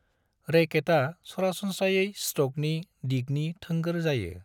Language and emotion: Bodo, neutral